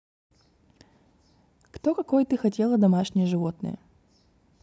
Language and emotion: Russian, neutral